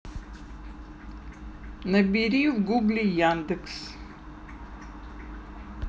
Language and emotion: Russian, neutral